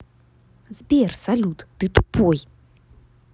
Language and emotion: Russian, angry